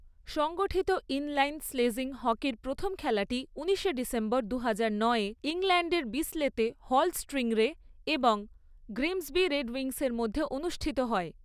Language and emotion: Bengali, neutral